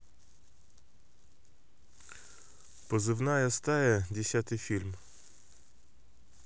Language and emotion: Russian, neutral